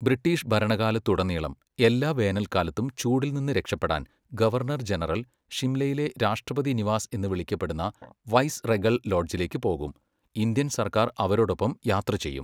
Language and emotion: Malayalam, neutral